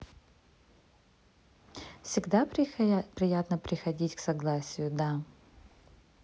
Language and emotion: Russian, neutral